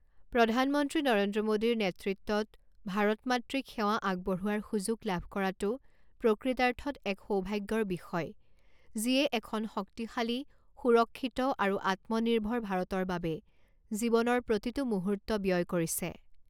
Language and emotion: Assamese, neutral